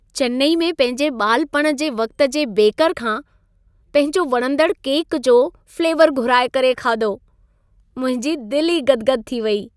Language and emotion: Sindhi, happy